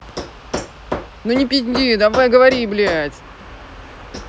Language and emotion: Russian, angry